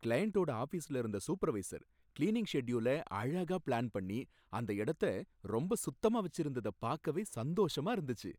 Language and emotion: Tamil, happy